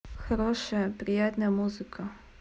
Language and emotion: Russian, neutral